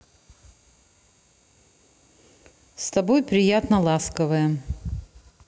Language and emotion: Russian, neutral